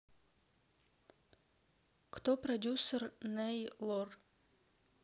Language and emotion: Russian, neutral